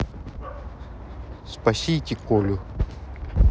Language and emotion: Russian, neutral